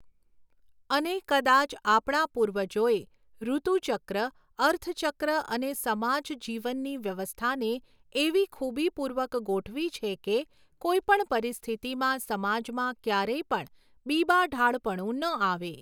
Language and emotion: Gujarati, neutral